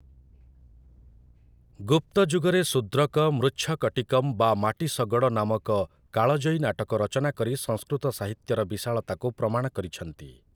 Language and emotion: Odia, neutral